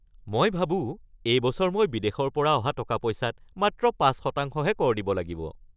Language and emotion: Assamese, happy